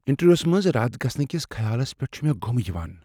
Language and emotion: Kashmiri, fearful